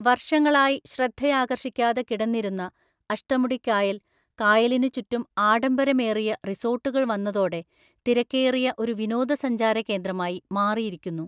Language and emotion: Malayalam, neutral